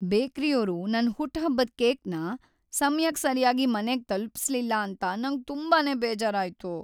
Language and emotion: Kannada, sad